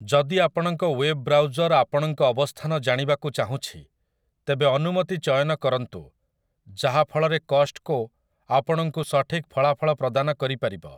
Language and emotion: Odia, neutral